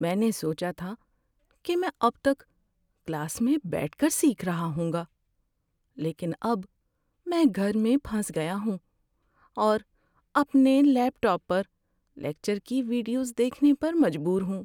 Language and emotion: Urdu, sad